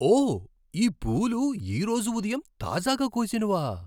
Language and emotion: Telugu, surprised